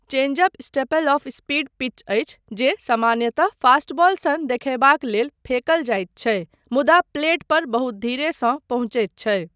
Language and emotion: Maithili, neutral